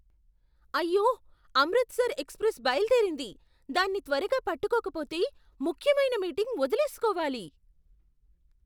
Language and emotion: Telugu, surprised